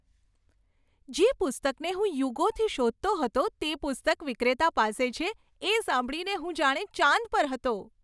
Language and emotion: Gujarati, happy